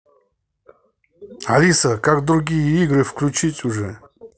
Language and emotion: Russian, angry